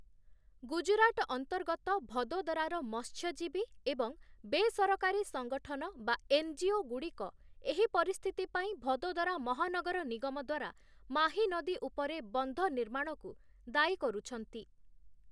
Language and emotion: Odia, neutral